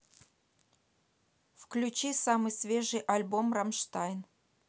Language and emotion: Russian, neutral